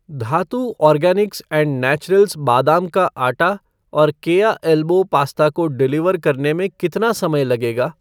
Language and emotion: Hindi, neutral